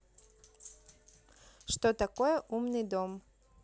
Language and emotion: Russian, neutral